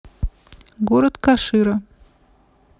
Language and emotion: Russian, neutral